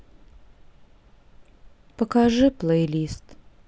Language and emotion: Russian, sad